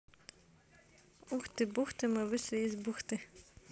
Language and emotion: Russian, positive